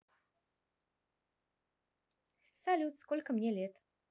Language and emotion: Russian, positive